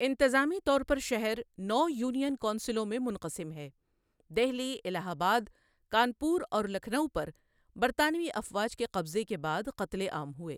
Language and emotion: Urdu, neutral